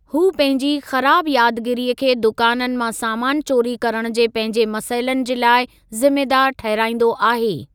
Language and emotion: Sindhi, neutral